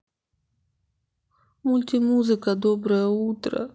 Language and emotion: Russian, sad